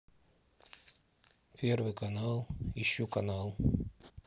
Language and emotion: Russian, neutral